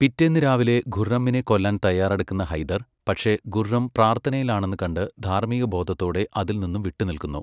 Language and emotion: Malayalam, neutral